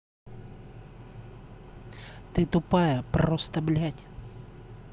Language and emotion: Russian, angry